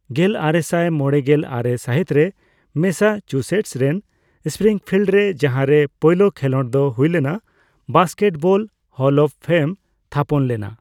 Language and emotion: Santali, neutral